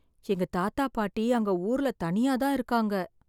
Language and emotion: Tamil, sad